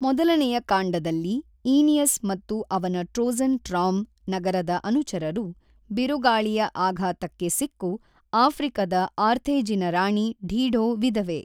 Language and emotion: Kannada, neutral